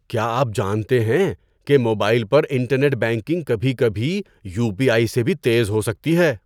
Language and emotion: Urdu, surprised